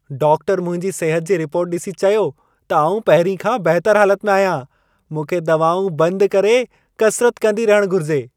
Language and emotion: Sindhi, happy